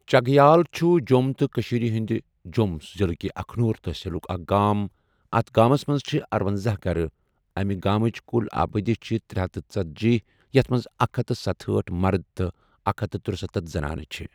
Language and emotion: Kashmiri, neutral